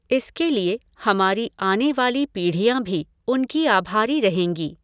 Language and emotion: Hindi, neutral